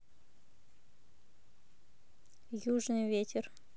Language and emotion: Russian, neutral